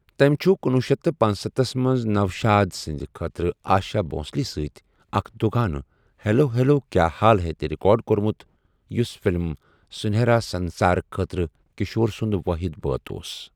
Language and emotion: Kashmiri, neutral